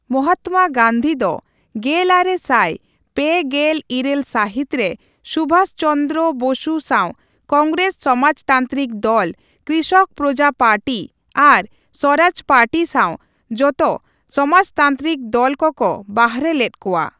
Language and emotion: Santali, neutral